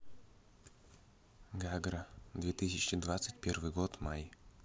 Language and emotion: Russian, neutral